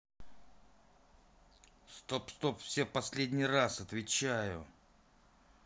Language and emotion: Russian, angry